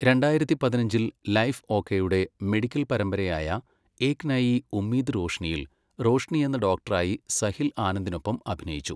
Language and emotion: Malayalam, neutral